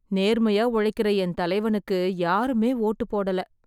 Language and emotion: Tamil, sad